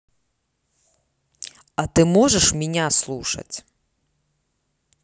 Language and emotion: Russian, neutral